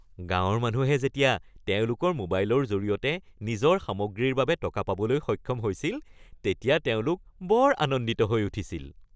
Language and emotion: Assamese, happy